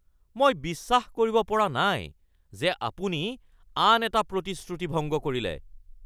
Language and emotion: Assamese, angry